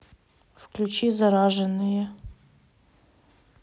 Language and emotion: Russian, neutral